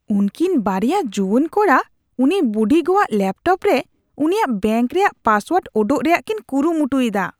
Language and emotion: Santali, disgusted